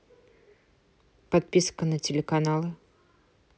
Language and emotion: Russian, neutral